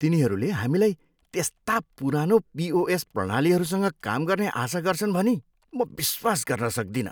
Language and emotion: Nepali, disgusted